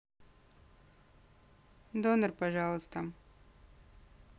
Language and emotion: Russian, neutral